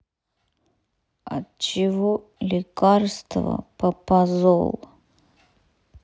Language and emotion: Russian, sad